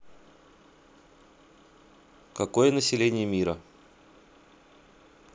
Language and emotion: Russian, neutral